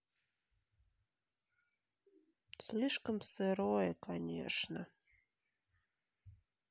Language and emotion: Russian, sad